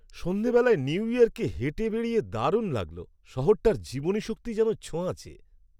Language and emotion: Bengali, happy